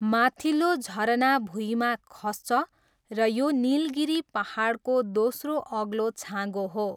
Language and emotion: Nepali, neutral